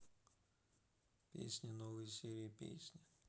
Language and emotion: Russian, neutral